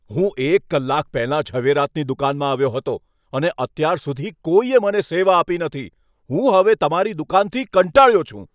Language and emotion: Gujarati, angry